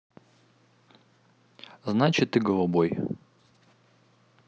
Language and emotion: Russian, neutral